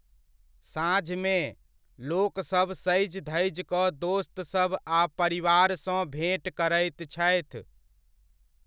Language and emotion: Maithili, neutral